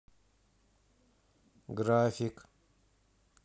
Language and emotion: Russian, neutral